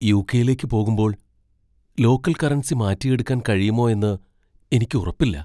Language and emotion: Malayalam, fearful